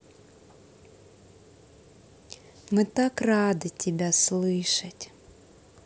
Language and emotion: Russian, positive